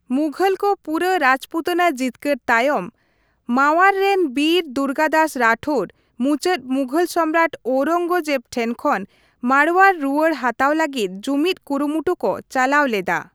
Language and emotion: Santali, neutral